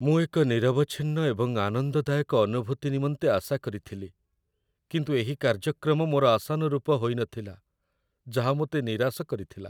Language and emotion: Odia, sad